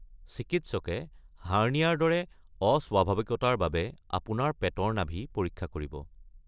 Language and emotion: Assamese, neutral